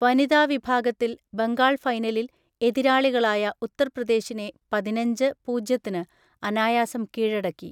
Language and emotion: Malayalam, neutral